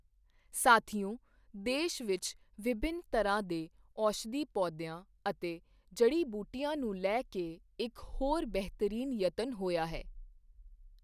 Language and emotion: Punjabi, neutral